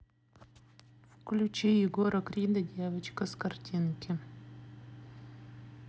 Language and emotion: Russian, neutral